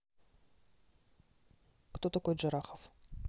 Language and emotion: Russian, neutral